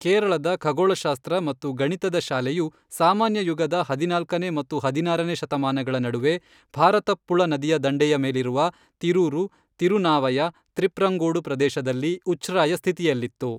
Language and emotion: Kannada, neutral